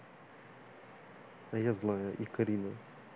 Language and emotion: Russian, neutral